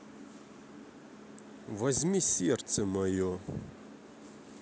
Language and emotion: Russian, angry